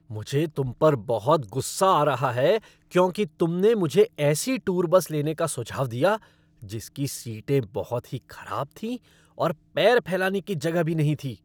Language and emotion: Hindi, angry